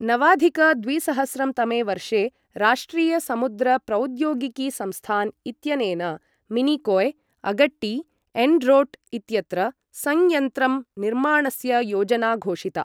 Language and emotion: Sanskrit, neutral